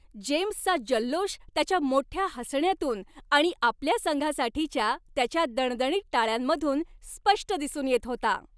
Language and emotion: Marathi, happy